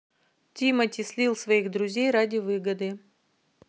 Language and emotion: Russian, neutral